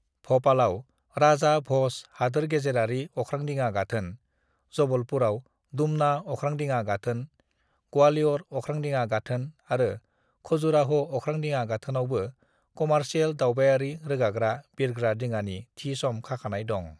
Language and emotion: Bodo, neutral